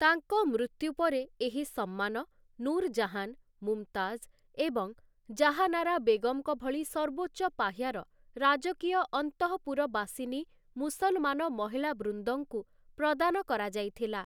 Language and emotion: Odia, neutral